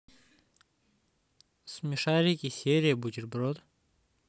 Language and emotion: Russian, neutral